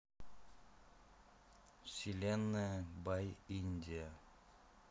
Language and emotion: Russian, neutral